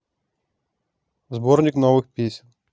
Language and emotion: Russian, neutral